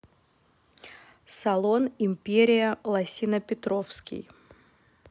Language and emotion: Russian, neutral